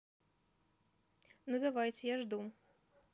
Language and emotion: Russian, neutral